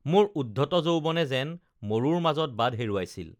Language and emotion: Assamese, neutral